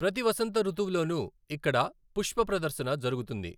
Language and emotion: Telugu, neutral